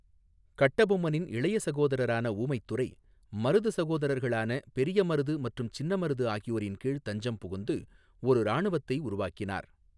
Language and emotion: Tamil, neutral